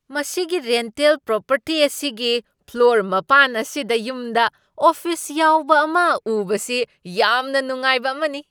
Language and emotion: Manipuri, surprised